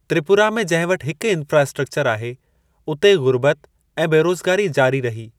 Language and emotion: Sindhi, neutral